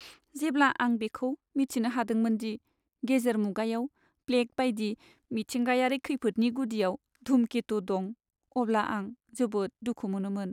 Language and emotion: Bodo, sad